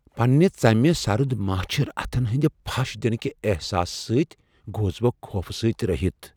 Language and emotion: Kashmiri, fearful